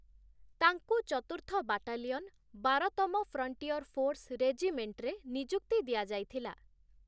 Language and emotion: Odia, neutral